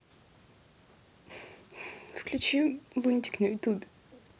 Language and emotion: Russian, neutral